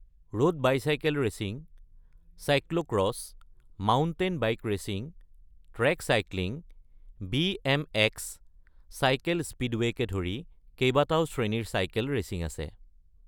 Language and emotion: Assamese, neutral